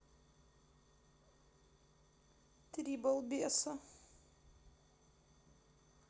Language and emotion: Russian, sad